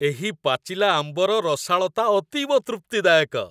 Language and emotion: Odia, happy